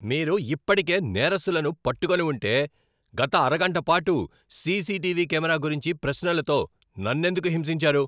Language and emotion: Telugu, angry